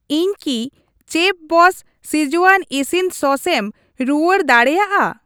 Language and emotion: Santali, neutral